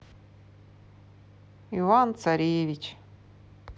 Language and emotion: Russian, sad